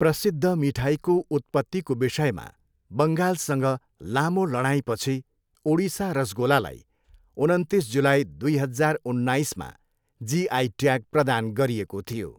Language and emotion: Nepali, neutral